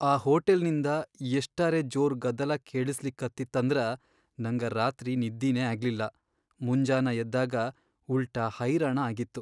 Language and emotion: Kannada, sad